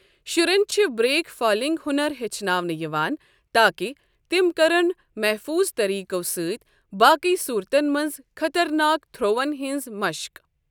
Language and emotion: Kashmiri, neutral